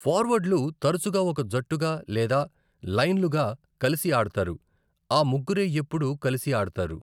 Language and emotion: Telugu, neutral